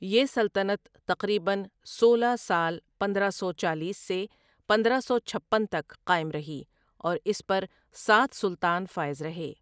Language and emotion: Urdu, neutral